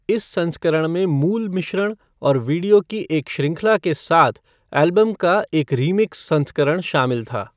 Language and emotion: Hindi, neutral